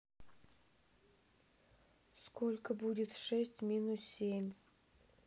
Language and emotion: Russian, neutral